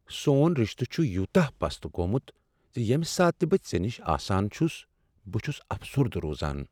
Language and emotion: Kashmiri, sad